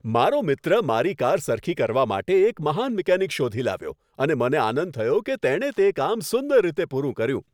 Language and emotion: Gujarati, happy